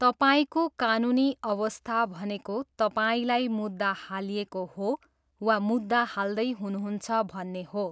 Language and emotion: Nepali, neutral